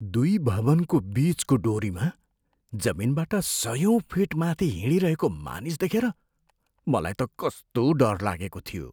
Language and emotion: Nepali, fearful